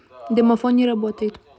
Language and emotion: Russian, neutral